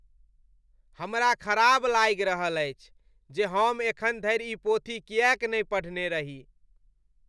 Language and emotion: Maithili, disgusted